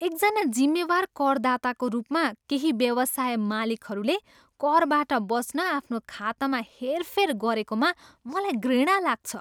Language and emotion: Nepali, disgusted